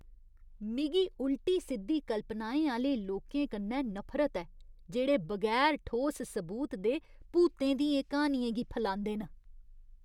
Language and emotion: Dogri, disgusted